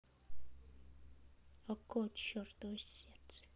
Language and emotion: Russian, sad